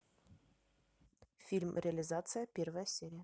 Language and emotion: Russian, neutral